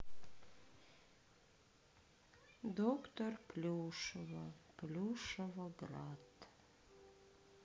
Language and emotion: Russian, sad